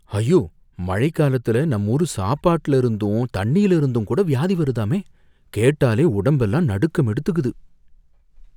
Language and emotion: Tamil, fearful